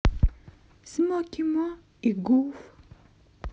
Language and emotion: Russian, positive